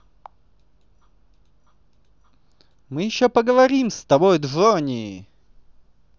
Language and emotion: Russian, positive